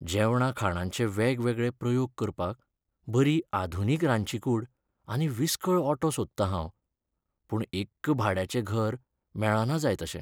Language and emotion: Goan Konkani, sad